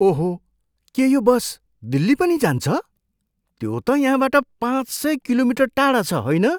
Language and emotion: Nepali, surprised